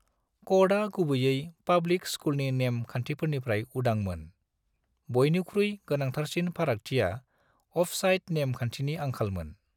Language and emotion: Bodo, neutral